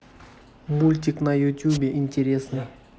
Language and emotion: Russian, neutral